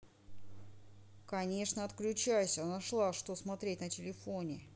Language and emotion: Russian, angry